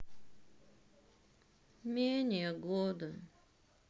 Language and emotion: Russian, sad